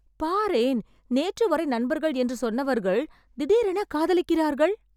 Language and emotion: Tamil, surprised